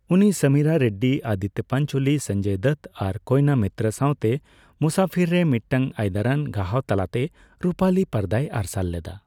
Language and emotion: Santali, neutral